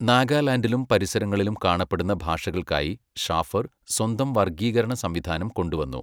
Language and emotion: Malayalam, neutral